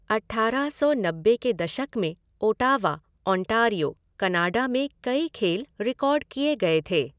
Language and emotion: Hindi, neutral